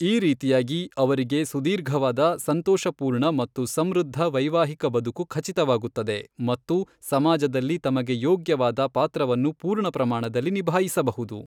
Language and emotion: Kannada, neutral